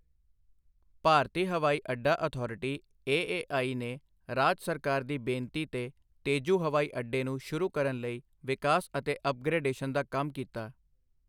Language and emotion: Punjabi, neutral